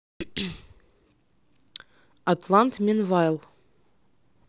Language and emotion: Russian, neutral